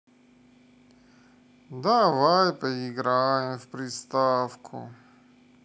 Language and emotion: Russian, sad